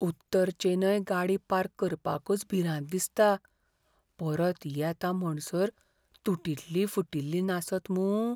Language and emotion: Goan Konkani, fearful